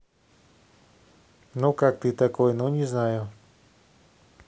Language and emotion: Russian, neutral